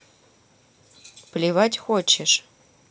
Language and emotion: Russian, neutral